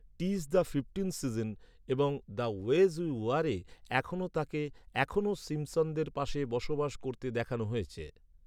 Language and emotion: Bengali, neutral